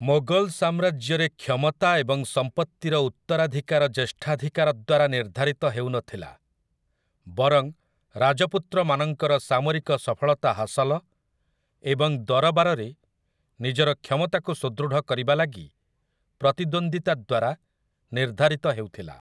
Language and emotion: Odia, neutral